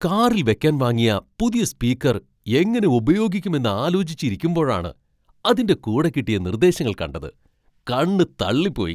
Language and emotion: Malayalam, surprised